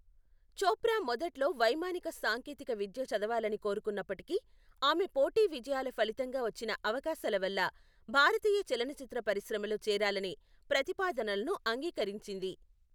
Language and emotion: Telugu, neutral